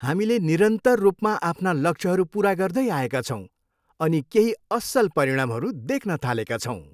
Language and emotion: Nepali, happy